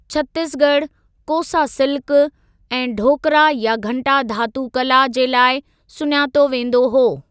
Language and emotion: Sindhi, neutral